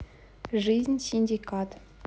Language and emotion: Russian, neutral